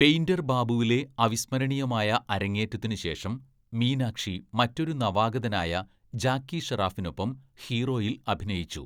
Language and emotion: Malayalam, neutral